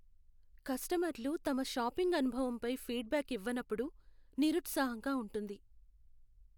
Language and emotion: Telugu, sad